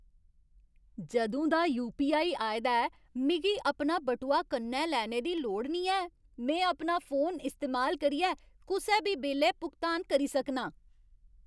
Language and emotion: Dogri, happy